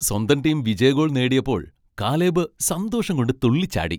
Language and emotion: Malayalam, happy